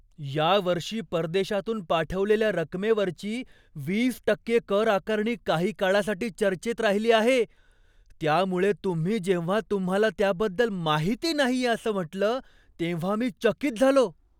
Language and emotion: Marathi, surprised